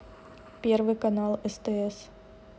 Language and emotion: Russian, neutral